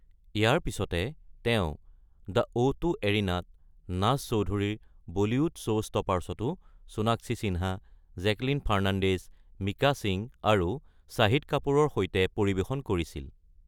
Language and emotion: Assamese, neutral